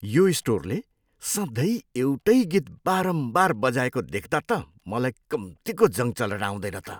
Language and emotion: Nepali, disgusted